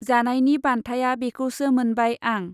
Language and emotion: Bodo, neutral